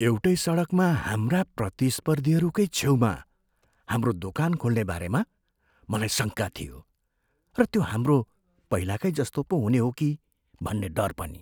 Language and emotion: Nepali, fearful